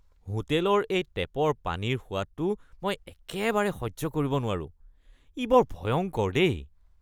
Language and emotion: Assamese, disgusted